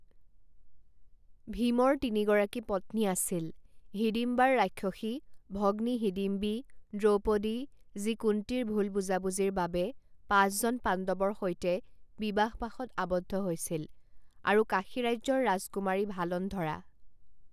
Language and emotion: Assamese, neutral